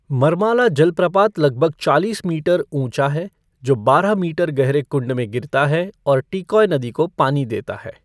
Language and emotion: Hindi, neutral